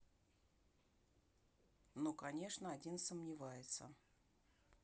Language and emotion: Russian, neutral